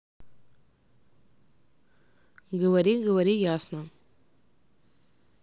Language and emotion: Russian, neutral